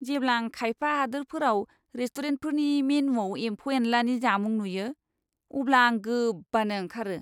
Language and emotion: Bodo, disgusted